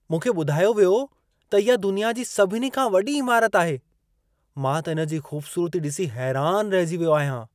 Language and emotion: Sindhi, surprised